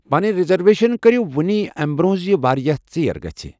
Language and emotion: Kashmiri, neutral